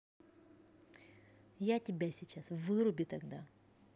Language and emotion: Russian, angry